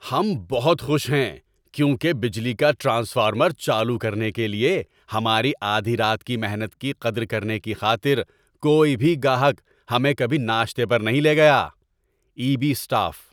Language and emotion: Urdu, happy